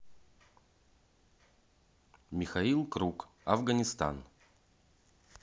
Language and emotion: Russian, neutral